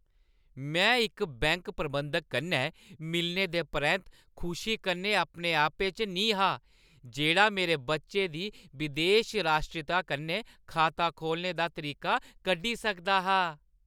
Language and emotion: Dogri, happy